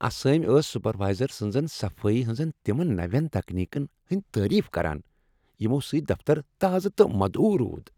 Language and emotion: Kashmiri, happy